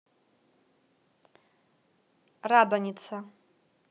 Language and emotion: Russian, neutral